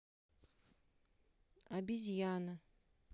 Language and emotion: Russian, neutral